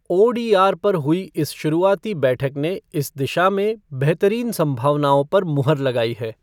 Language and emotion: Hindi, neutral